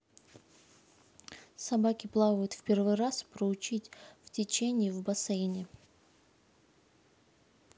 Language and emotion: Russian, neutral